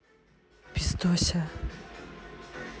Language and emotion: Russian, neutral